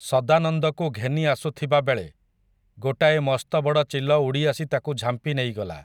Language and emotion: Odia, neutral